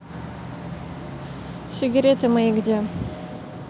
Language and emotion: Russian, neutral